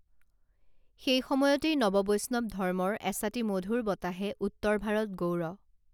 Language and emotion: Assamese, neutral